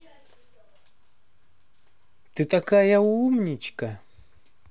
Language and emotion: Russian, positive